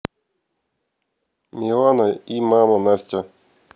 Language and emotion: Russian, neutral